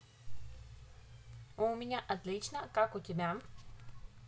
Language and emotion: Russian, positive